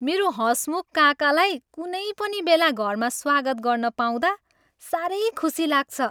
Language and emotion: Nepali, happy